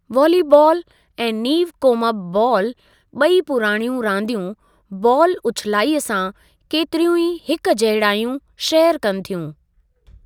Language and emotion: Sindhi, neutral